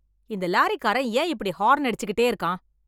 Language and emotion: Tamil, angry